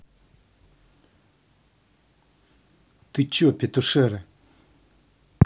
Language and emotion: Russian, angry